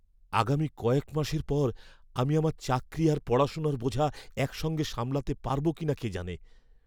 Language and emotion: Bengali, fearful